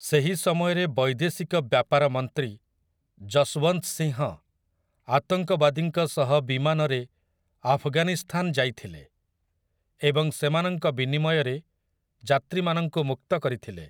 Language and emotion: Odia, neutral